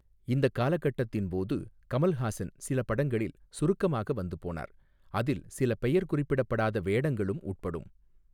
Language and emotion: Tamil, neutral